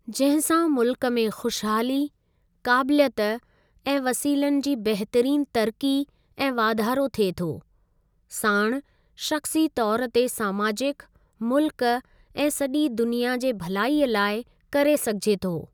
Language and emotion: Sindhi, neutral